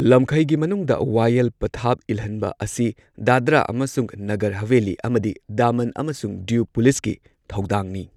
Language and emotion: Manipuri, neutral